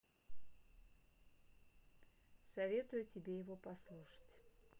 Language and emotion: Russian, neutral